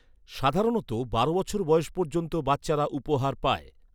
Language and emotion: Bengali, neutral